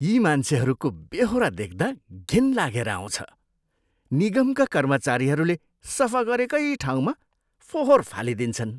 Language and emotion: Nepali, disgusted